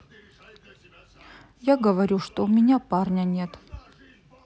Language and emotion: Russian, sad